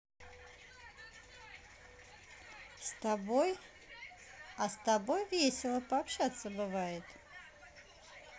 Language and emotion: Russian, positive